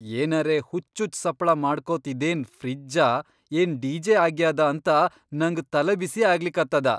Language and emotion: Kannada, surprised